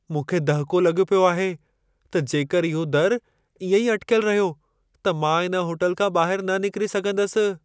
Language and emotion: Sindhi, fearful